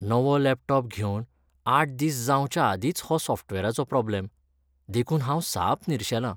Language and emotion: Goan Konkani, sad